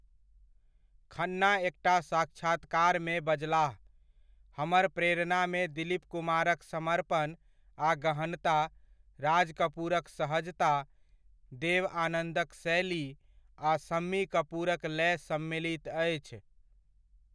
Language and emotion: Maithili, neutral